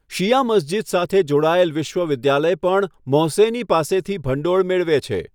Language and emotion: Gujarati, neutral